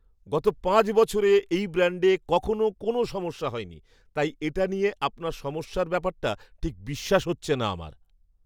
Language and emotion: Bengali, surprised